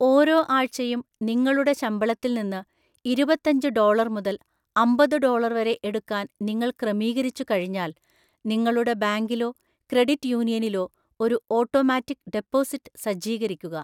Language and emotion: Malayalam, neutral